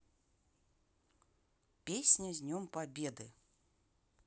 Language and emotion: Russian, neutral